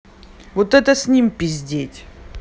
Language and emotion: Russian, angry